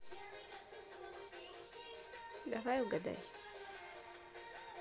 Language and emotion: Russian, neutral